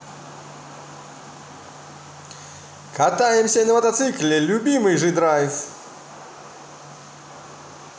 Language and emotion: Russian, positive